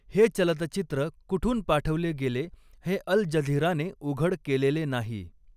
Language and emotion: Marathi, neutral